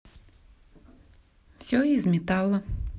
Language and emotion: Russian, positive